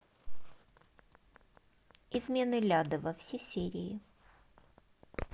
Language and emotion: Russian, neutral